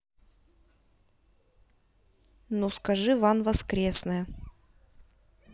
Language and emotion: Russian, neutral